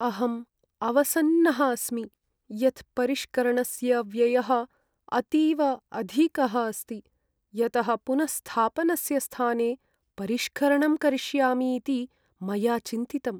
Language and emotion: Sanskrit, sad